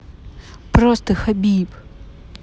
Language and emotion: Russian, angry